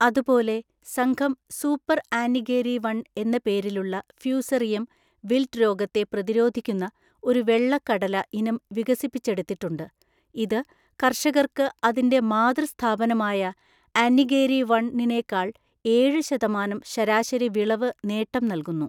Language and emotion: Malayalam, neutral